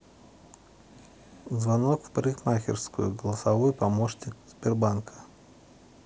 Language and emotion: Russian, neutral